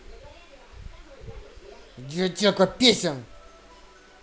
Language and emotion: Russian, angry